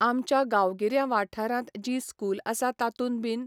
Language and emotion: Goan Konkani, neutral